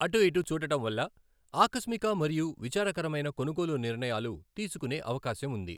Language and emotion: Telugu, neutral